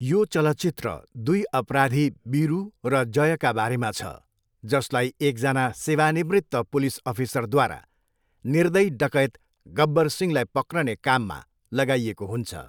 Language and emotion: Nepali, neutral